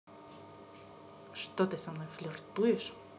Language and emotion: Russian, angry